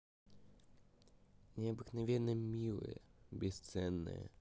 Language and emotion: Russian, neutral